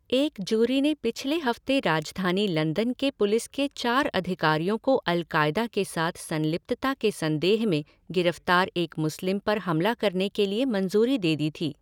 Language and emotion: Hindi, neutral